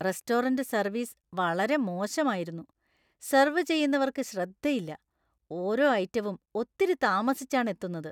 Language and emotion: Malayalam, disgusted